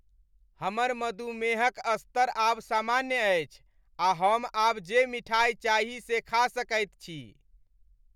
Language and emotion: Maithili, happy